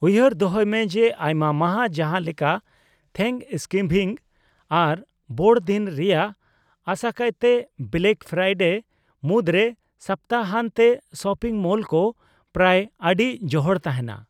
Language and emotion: Santali, neutral